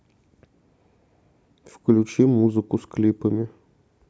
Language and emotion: Russian, neutral